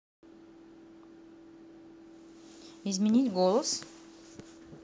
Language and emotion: Russian, neutral